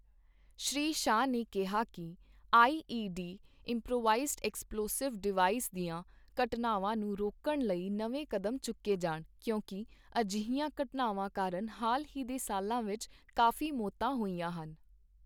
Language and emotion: Punjabi, neutral